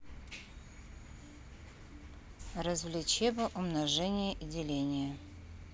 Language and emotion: Russian, neutral